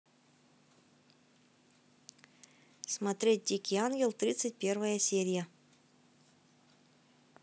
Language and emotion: Russian, neutral